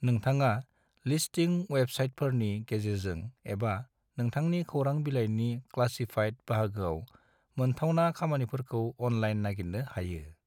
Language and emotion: Bodo, neutral